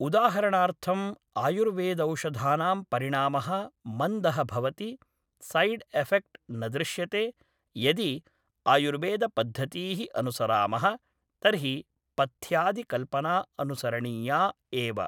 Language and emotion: Sanskrit, neutral